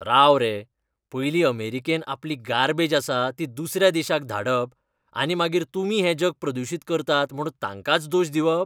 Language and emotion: Goan Konkani, disgusted